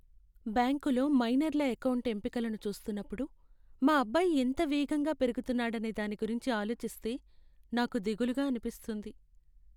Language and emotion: Telugu, sad